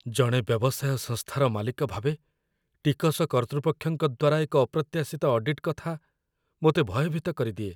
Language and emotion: Odia, fearful